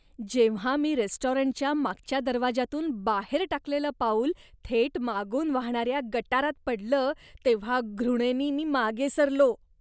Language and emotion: Marathi, disgusted